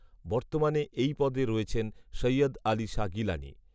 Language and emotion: Bengali, neutral